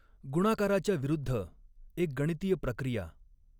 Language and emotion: Marathi, neutral